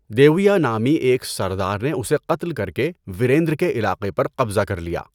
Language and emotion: Urdu, neutral